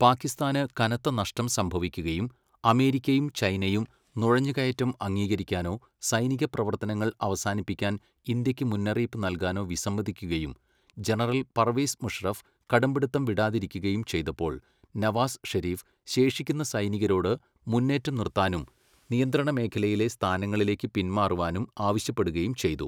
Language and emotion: Malayalam, neutral